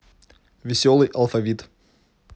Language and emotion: Russian, neutral